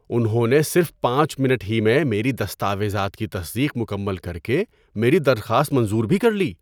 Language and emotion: Urdu, surprised